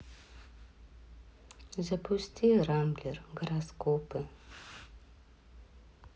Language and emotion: Russian, sad